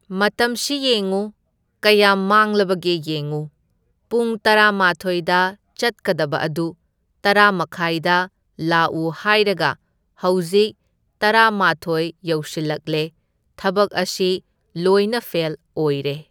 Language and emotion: Manipuri, neutral